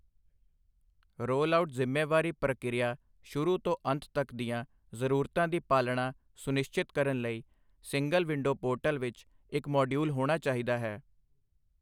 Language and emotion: Punjabi, neutral